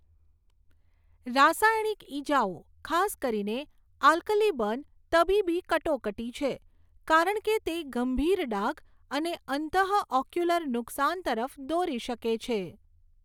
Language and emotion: Gujarati, neutral